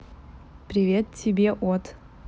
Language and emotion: Russian, neutral